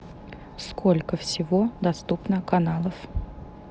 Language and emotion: Russian, neutral